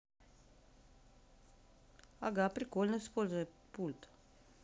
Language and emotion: Russian, neutral